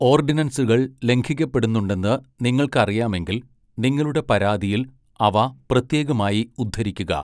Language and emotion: Malayalam, neutral